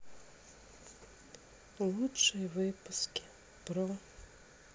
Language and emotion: Russian, sad